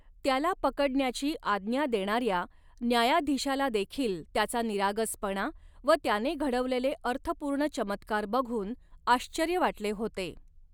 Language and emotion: Marathi, neutral